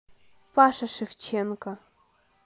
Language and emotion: Russian, neutral